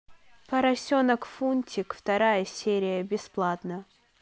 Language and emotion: Russian, neutral